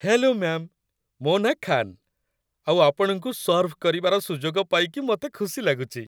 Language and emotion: Odia, happy